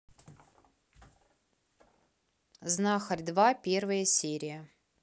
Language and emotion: Russian, neutral